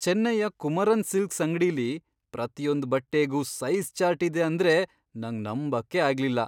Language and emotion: Kannada, surprised